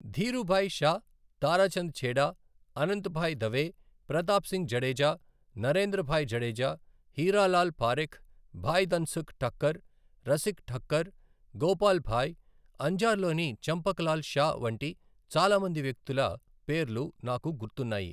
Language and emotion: Telugu, neutral